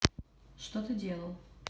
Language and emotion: Russian, neutral